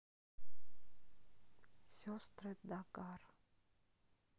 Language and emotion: Russian, neutral